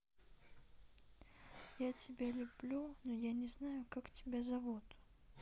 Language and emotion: Russian, sad